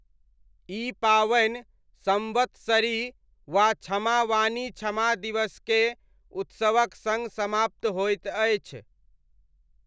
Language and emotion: Maithili, neutral